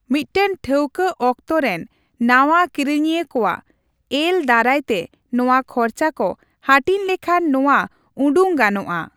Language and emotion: Santali, neutral